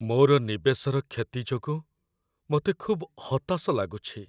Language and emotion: Odia, sad